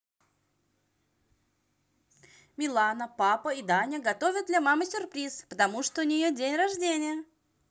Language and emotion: Russian, positive